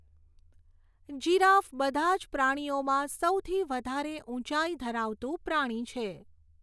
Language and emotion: Gujarati, neutral